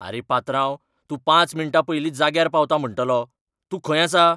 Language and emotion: Goan Konkani, angry